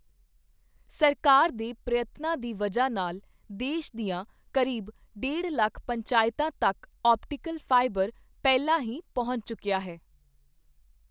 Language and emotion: Punjabi, neutral